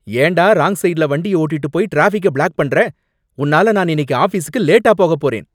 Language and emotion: Tamil, angry